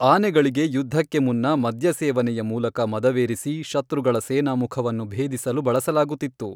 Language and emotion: Kannada, neutral